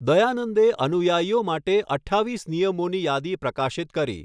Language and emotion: Gujarati, neutral